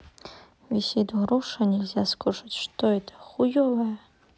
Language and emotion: Russian, neutral